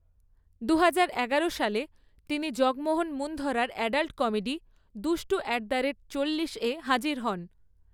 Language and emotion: Bengali, neutral